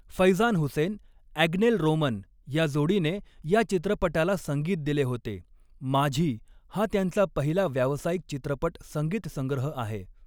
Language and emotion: Marathi, neutral